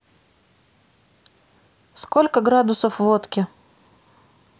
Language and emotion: Russian, neutral